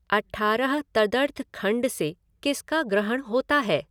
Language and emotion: Hindi, neutral